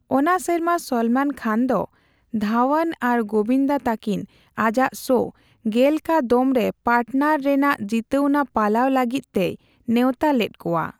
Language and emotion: Santali, neutral